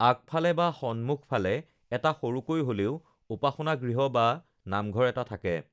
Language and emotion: Assamese, neutral